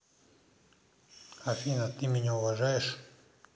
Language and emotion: Russian, neutral